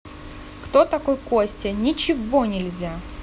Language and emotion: Russian, angry